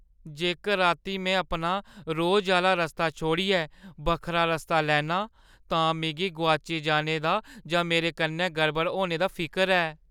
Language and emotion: Dogri, fearful